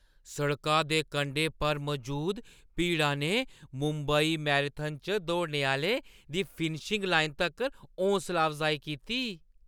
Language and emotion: Dogri, happy